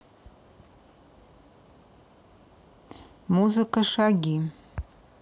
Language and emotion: Russian, neutral